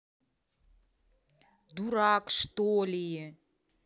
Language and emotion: Russian, angry